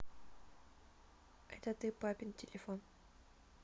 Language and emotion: Russian, neutral